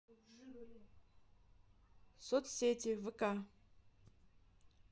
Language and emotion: Russian, neutral